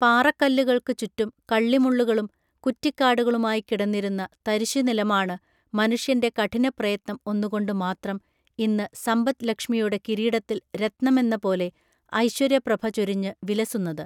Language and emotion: Malayalam, neutral